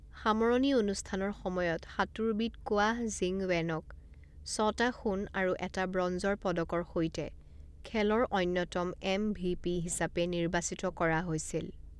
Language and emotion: Assamese, neutral